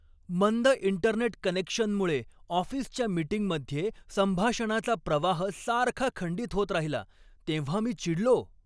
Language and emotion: Marathi, angry